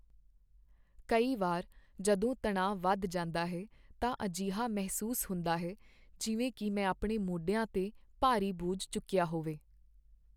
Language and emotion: Punjabi, sad